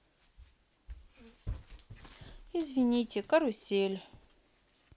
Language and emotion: Russian, neutral